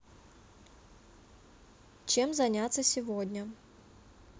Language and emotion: Russian, neutral